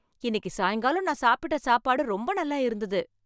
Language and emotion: Tamil, happy